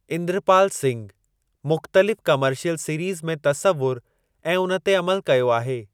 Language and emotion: Sindhi, neutral